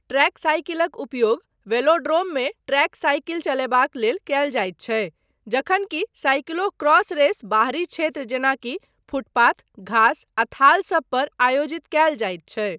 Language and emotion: Maithili, neutral